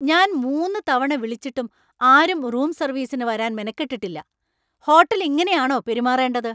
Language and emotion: Malayalam, angry